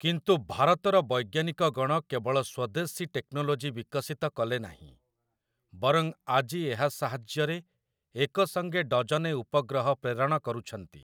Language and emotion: Odia, neutral